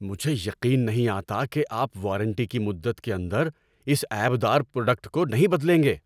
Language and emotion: Urdu, angry